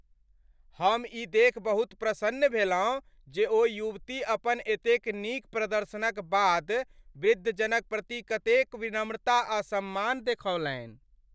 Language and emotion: Maithili, happy